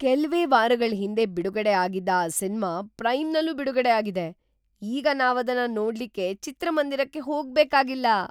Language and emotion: Kannada, surprised